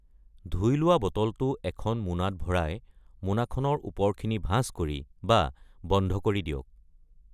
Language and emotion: Assamese, neutral